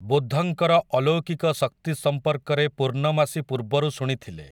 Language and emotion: Odia, neutral